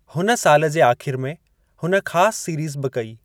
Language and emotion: Sindhi, neutral